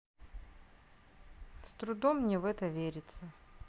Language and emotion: Russian, sad